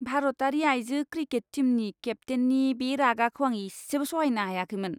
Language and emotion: Bodo, disgusted